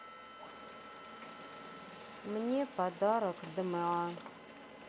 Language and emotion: Russian, sad